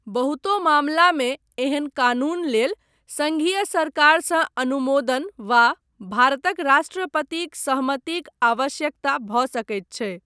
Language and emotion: Maithili, neutral